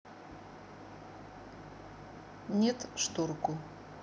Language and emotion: Russian, neutral